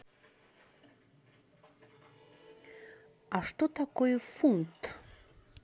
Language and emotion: Russian, neutral